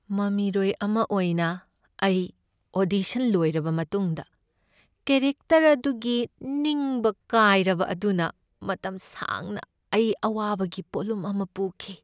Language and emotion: Manipuri, sad